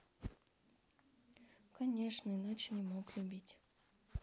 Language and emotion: Russian, sad